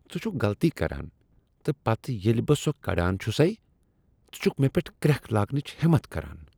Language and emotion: Kashmiri, disgusted